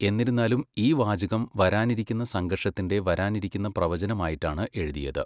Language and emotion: Malayalam, neutral